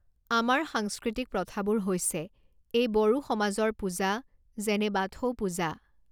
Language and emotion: Assamese, neutral